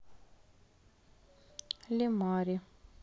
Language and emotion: Russian, sad